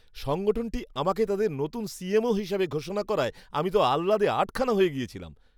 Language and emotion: Bengali, happy